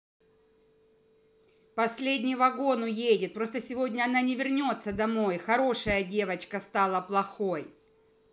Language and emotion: Russian, angry